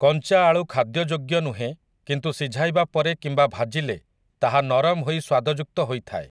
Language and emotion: Odia, neutral